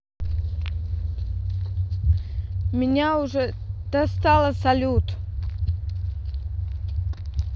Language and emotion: Russian, angry